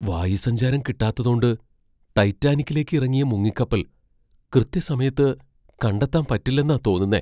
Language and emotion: Malayalam, fearful